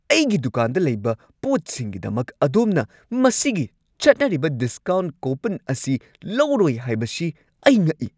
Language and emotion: Manipuri, angry